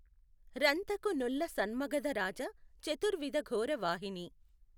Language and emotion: Telugu, neutral